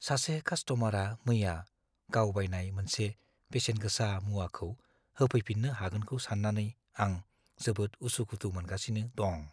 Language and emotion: Bodo, fearful